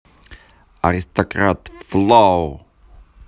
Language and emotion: Russian, positive